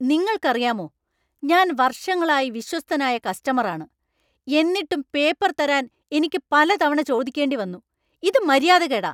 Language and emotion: Malayalam, angry